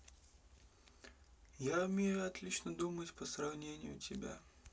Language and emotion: Russian, neutral